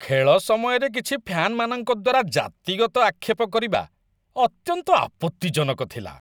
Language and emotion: Odia, disgusted